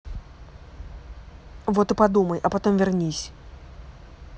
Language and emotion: Russian, angry